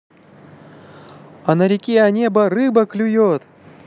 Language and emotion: Russian, positive